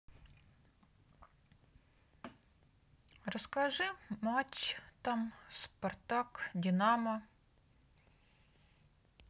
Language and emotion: Russian, neutral